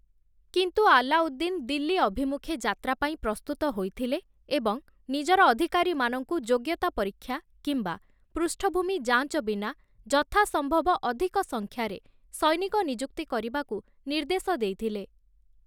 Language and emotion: Odia, neutral